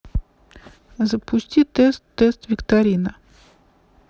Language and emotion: Russian, neutral